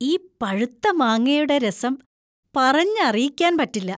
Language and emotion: Malayalam, happy